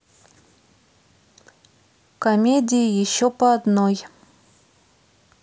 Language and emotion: Russian, neutral